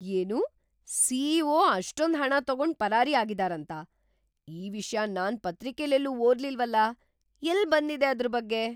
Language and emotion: Kannada, surprised